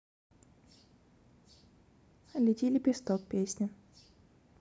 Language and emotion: Russian, neutral